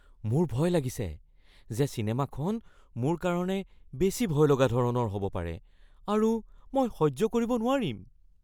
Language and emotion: Assamese, fearful